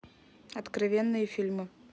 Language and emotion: Russian, neutral